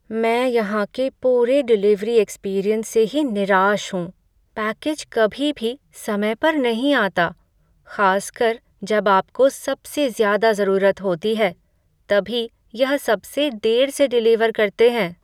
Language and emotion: Hindi, sad